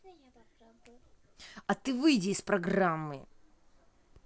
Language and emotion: Russian, angry